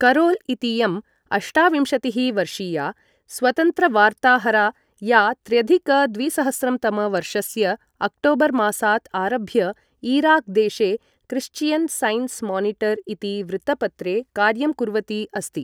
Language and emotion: Sanskrit, neutral